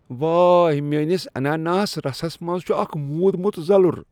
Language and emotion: Kashmiri, disgusted